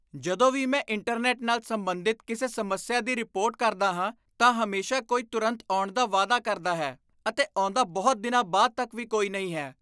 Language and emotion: Punjabi, disgusted